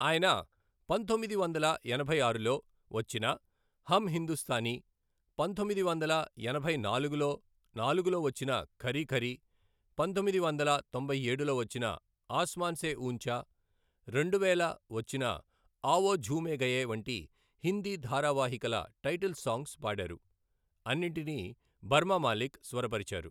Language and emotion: Telugu, neutral